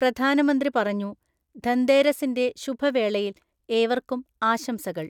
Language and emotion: Malayalam, neutral